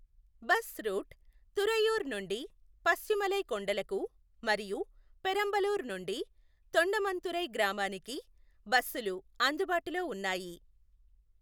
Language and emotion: Telugu, neutral